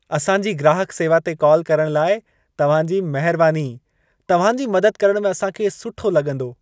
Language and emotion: Sindhi, happy